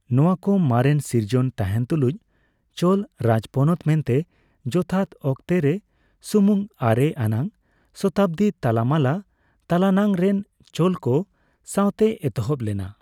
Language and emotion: Santali, neutral